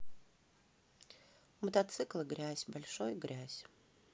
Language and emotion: Russian, neutral